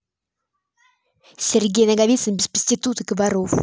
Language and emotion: Russian, angry